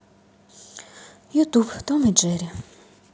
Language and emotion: Russian, sad